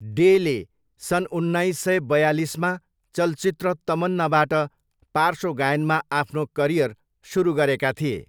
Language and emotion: Nepali, neutral